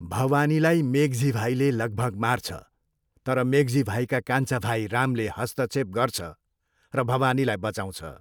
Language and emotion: Nepali, neutral